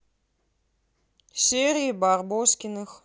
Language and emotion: Russian, neutral